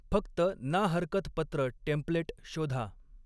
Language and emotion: Marathi, neutral